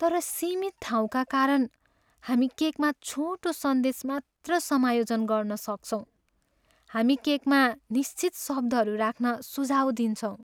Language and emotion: Nepali, sad